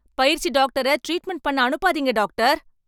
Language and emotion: Tamil, angry